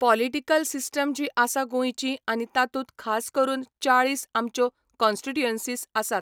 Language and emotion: Goan Konkani, neutral